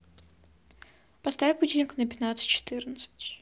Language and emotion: Russian, neutral